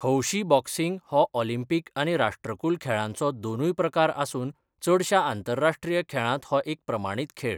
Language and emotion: Goan Konkani, neutral